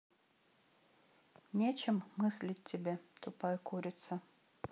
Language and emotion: Russian, neutral